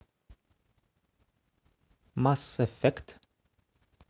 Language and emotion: Russian, neutral